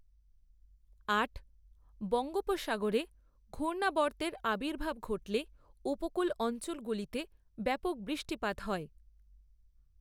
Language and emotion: Bengali, neutral